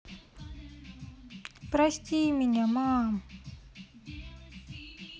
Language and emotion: Russian, sad